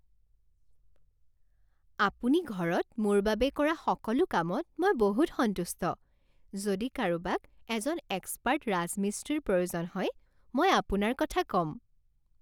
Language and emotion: Assamese, happy